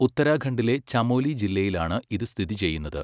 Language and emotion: Malayalam, neutral